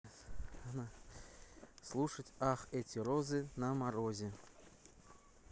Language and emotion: Russian, neutral